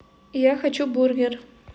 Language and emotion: Russian, neutral